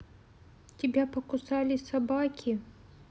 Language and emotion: Russian, sad